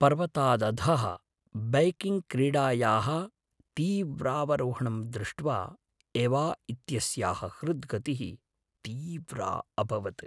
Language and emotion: Sanskrit, fearful